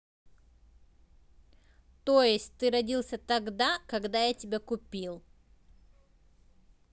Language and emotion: Russian, neutral